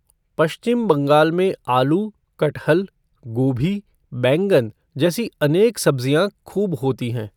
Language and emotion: Hindi, neutral